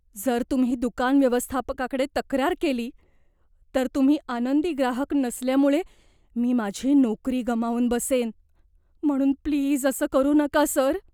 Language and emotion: Marathi, fearful